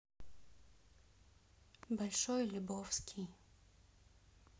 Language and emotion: Russian, neutral